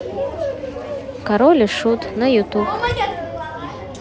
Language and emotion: Russian, positive